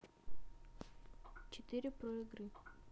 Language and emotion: Russian, neutral